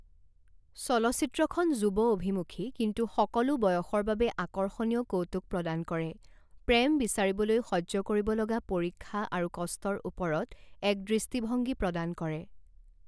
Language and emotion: Assamese, neutral